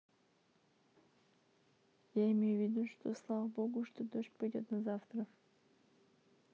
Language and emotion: Russian, neutral